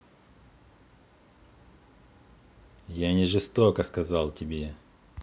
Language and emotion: Russian, angry